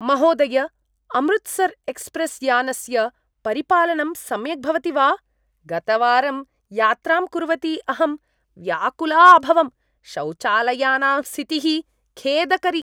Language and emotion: Sanskrit, disgusted